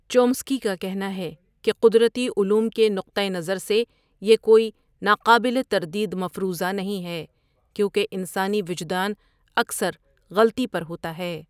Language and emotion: Urdu, neutral